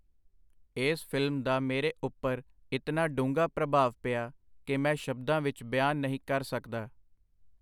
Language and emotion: Punjabi, neutral